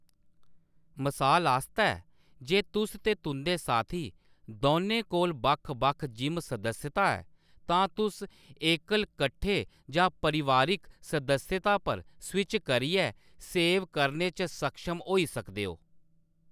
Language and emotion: Dogri, neutral